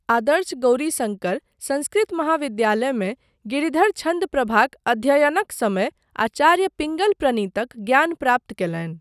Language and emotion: Maithili, neutral